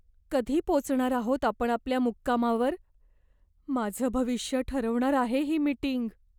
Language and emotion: Marathi, fearful